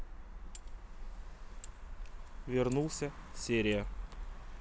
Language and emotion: Russian, neutral